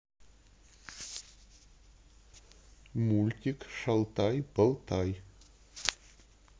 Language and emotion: Russian, neutral